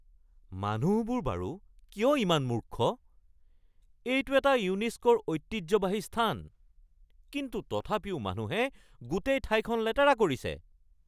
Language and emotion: Assamese, angry